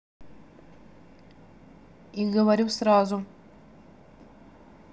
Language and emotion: Russian, neutral